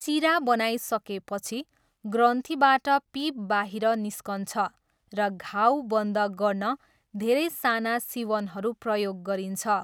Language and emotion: Nepali, neutral